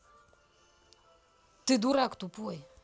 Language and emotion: Russian, angry